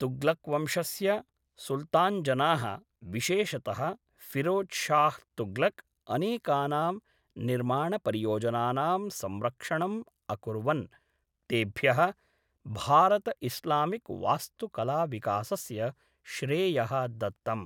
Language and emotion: Sanskrit, neutral